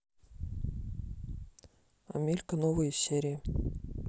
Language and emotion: Russian, neutral